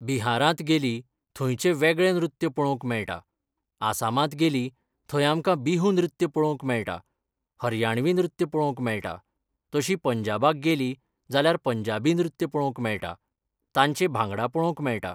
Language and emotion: Goan Konkani, neutral